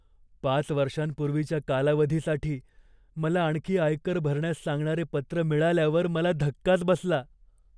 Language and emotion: Marathi, fearful